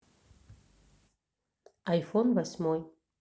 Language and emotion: Russian, neutral